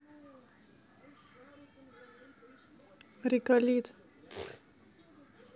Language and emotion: Russian, neutral